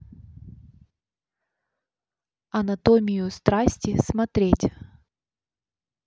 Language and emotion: Russian, neutral